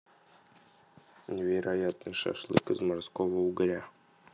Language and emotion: Russian, neutral